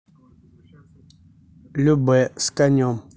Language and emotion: Russian, neutral